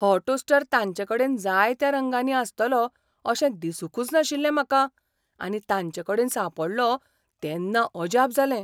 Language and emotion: Goan Konkani, surprised